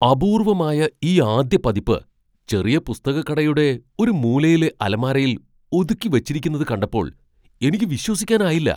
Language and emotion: Malayalam, surprised